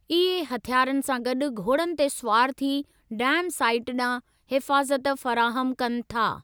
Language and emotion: Sindhi, neutral